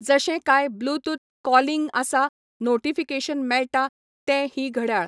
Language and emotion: Goan Konkani, neutral